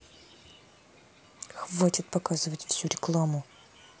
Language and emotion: Russian, angry